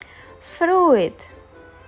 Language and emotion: Russian, neutral